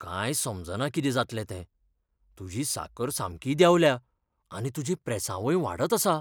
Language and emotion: Goan Konkani, fearful